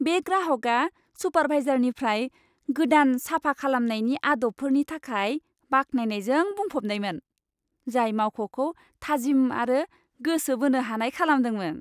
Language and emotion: Bodo, happy